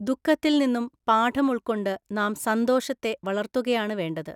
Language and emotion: Malayalam, neutral